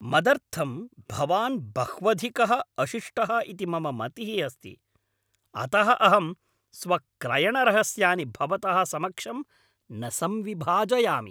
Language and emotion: Sanskrit, angry